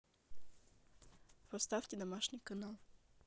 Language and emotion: Russian, neutral